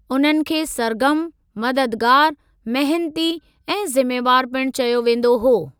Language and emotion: Sindhi, neutral